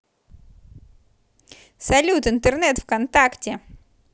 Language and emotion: Russian, positive